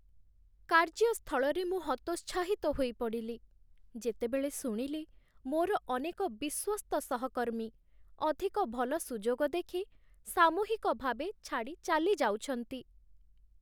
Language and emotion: Odia, sad